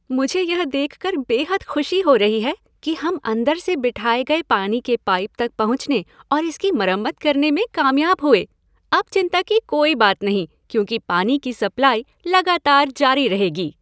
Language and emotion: Hindi, happy